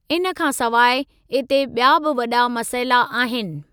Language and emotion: Sindhi, neutral